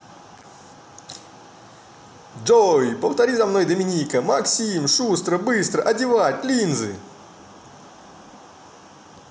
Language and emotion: Russian, positive